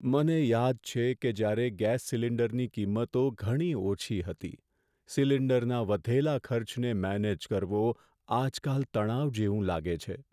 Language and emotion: Gujarati, sad